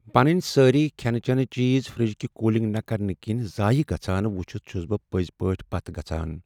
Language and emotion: Kashmiri, sad